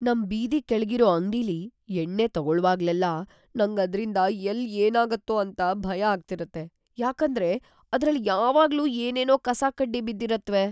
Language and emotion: Kannada, fearful